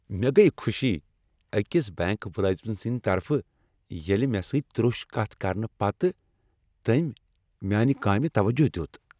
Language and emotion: Kashmiri, happy